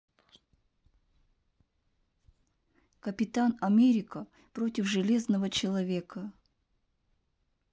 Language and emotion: Russian, neutral